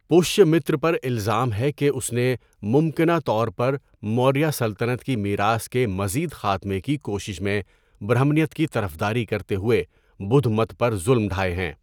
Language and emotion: Urdu, neutral